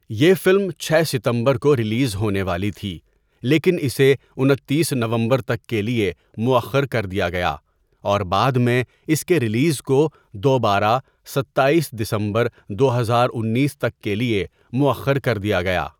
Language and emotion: Urdu, neutral